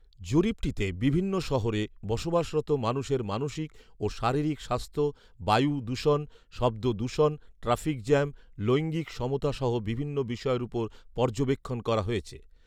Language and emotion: Bengali, neutral